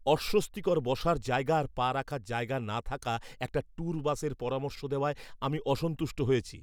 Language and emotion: Bengali, angry